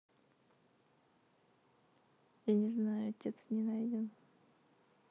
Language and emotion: Russian, sad